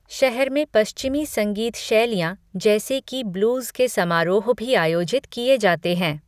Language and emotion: Hindi, neutral